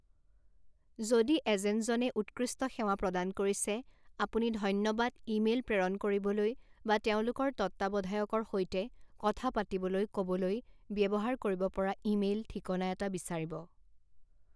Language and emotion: Assamese, neutral